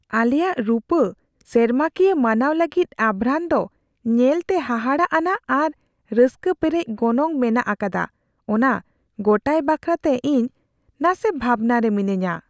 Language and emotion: Santali, fearful